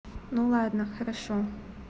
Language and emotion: Russian, neutral